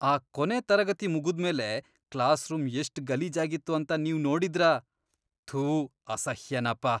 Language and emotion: Kannada, disgusted